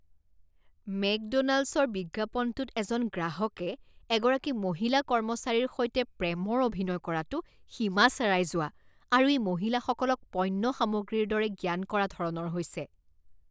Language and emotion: Assamese, disgusted